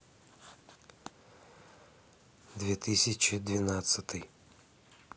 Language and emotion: Russian, neutral